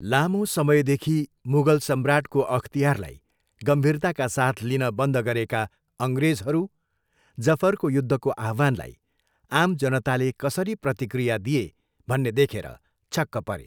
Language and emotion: Nepali, neutral